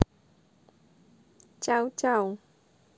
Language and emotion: Russian, neutral